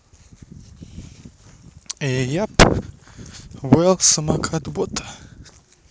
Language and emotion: Russian, neutral